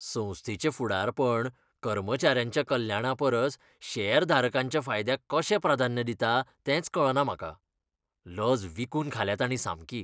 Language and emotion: Goan Konkani, disgusted